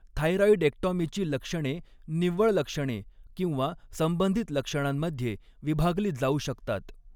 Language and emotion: Marathi, neutral